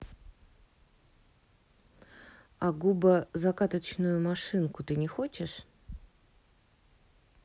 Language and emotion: Russian, neutral